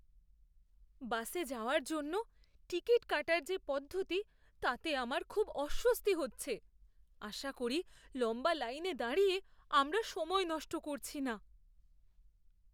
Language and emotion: Bengali, fearful